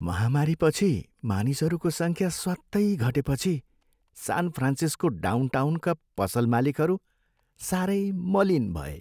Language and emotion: Nepali, sad